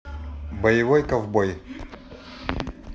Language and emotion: Russian, neutral